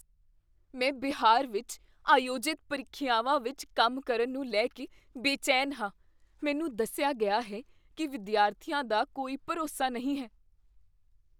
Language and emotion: Punjabi, fearful